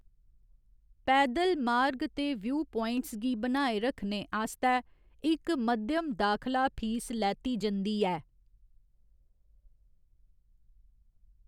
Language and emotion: Dogri, neutral